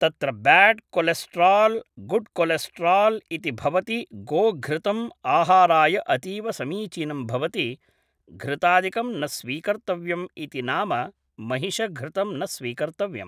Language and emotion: Sanskrit, neutral